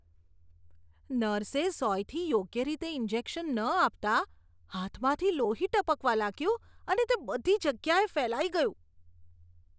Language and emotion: Gujarati, disgusted